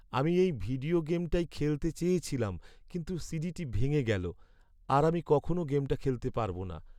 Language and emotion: Bengali, sad